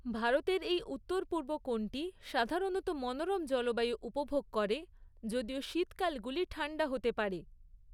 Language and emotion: Bengali, neutral